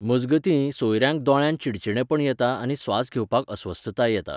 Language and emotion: Goan Konkani, neutral